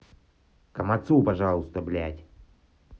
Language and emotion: Russian, angry